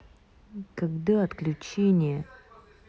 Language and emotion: Russian, angry